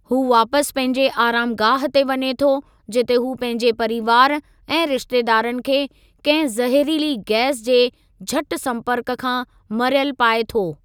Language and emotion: Sindhi, neutral